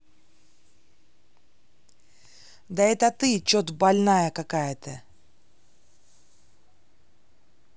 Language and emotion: Russian, angry